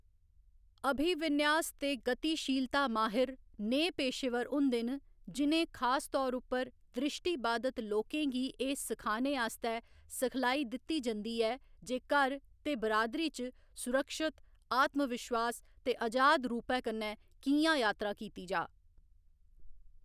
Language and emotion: Dogri, neutral